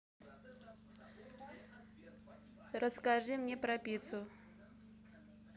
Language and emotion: Russian, neutral